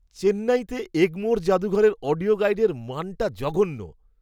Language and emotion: Bengali, disgusted